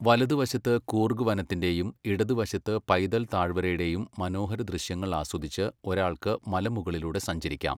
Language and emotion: Malayalam, neutral